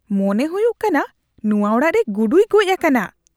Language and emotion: Santali, disgusted